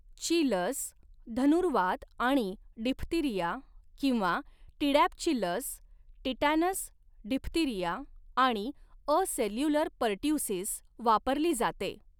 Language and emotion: Marathi, neutral